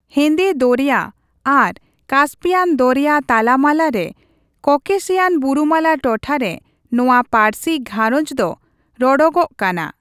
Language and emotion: Santali, neutral